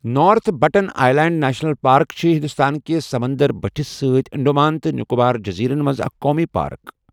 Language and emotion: Kashmiri, neutral